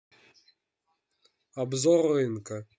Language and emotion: Russian, neutral